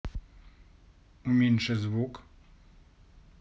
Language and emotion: Russian, neutral